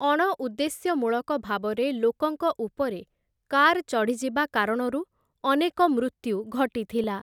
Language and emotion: Odia, neutral